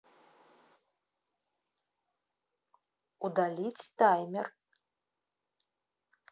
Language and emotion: Russian, neutral